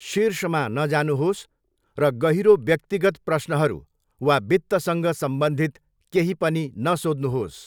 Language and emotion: Nepali, neutral